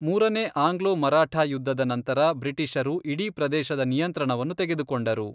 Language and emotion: Kannada, neutral